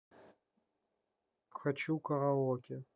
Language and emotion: Russian, neutral